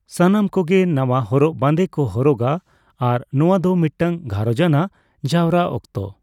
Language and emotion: Santali, neutral